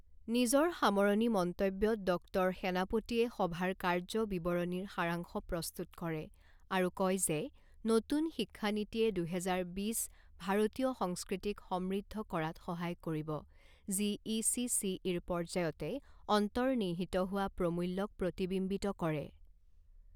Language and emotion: Assamese, neutral